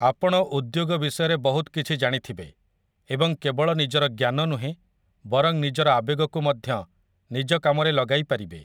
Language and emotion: Odia, neutral